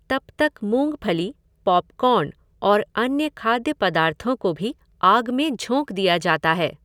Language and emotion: Hindi, neutral